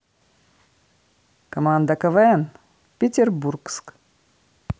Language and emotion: Russian, positive